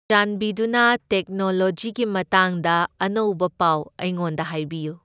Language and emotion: Manipuri, neutral